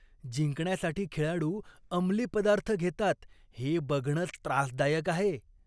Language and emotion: Marathi, disgusted